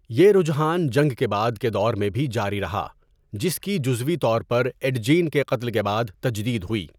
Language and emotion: Urdu, neutral